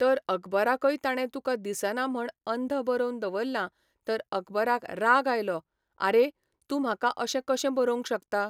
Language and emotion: Goan Konkani, neutral